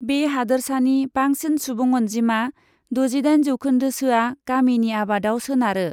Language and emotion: Bodo, neutral